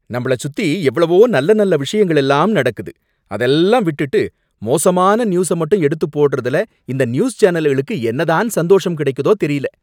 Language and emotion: Tamil, angry